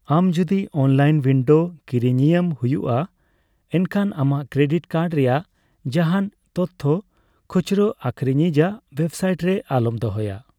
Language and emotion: Santali, neutral